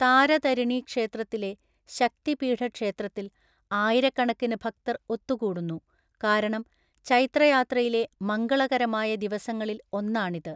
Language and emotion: Malayalam, neutral